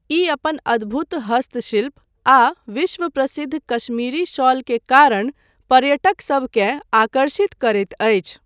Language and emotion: Maithili, neutral